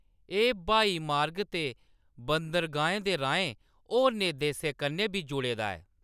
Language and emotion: Dogri, neutral